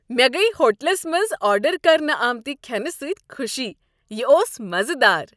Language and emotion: Kashmiri, happy